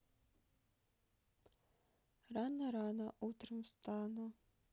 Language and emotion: Russian, sad